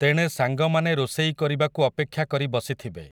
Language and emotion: Odia, neutral